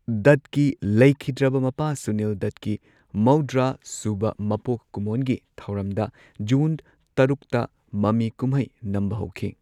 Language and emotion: Manipuri, neutral